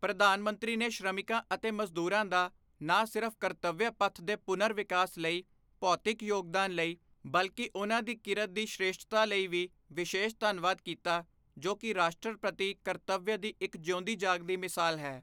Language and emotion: Punjabi, neutral